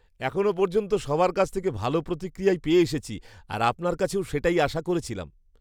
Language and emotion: Bengali, surprised